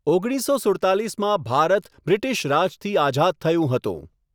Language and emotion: Gujarati, neutral